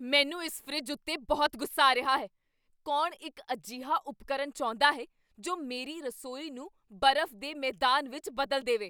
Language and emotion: Punjabi, angry